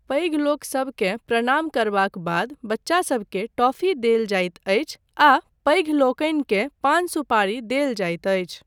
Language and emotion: Maithili, neutral